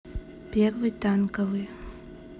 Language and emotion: Russian, neutral